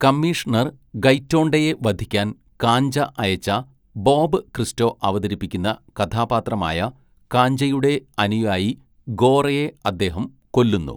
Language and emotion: Malayalam, neutral